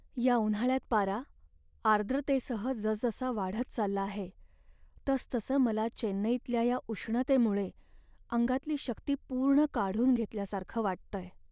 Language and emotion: Marathi, sad